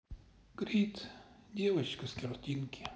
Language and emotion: Russian, sad